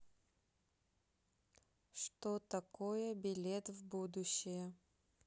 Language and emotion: Russian, neutral